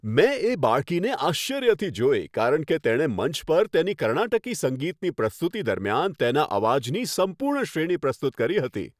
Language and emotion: Gujarati, happy